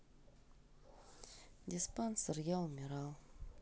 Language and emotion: Russian, sad